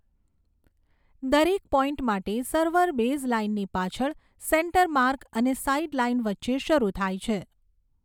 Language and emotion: Gujarati, neutral